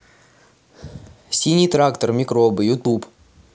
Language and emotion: Russian, angry